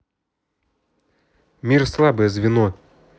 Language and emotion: Russian, neutral